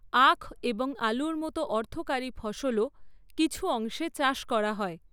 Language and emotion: Bengali, neutral